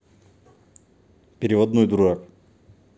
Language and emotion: Russian, neutral